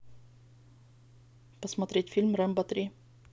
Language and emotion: Russian, neutral